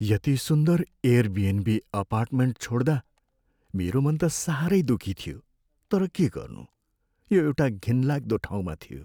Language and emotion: Nepali, sad